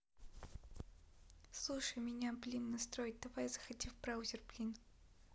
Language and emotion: Russian, neutral